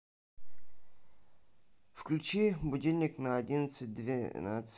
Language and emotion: Russian, neutral